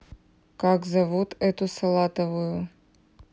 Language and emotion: Russian, neutral